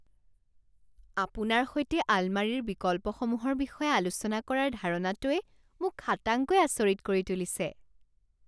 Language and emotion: Assamese, surprised